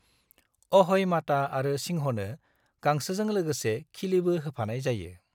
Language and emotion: Bodo, neutral